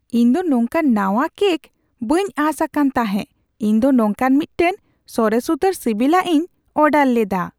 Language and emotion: Santali, surprised